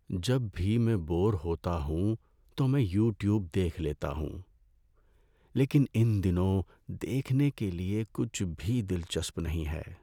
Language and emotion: Urdu, sad